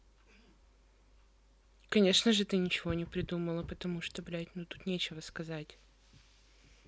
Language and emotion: Russian, neutral